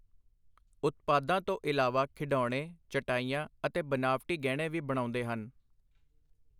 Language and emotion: Punjabi, neutral